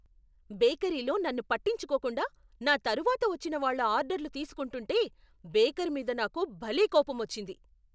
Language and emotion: Telugu, angry